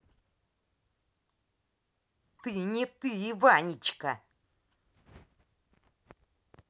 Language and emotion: Russian, angry